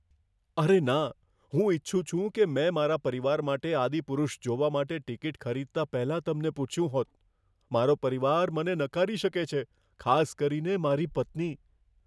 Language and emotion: Gujarati, fearful